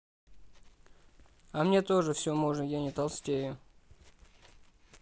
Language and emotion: Russian, neutral